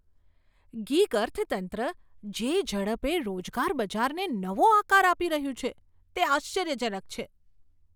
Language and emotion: Gujarati, surprised